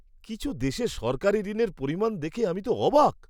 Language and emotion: Bengali, surprised